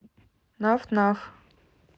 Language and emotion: Russian, neutral